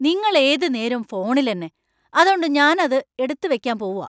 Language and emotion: Malayalam, angry